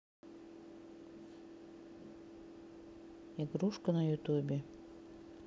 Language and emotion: Russian, neutral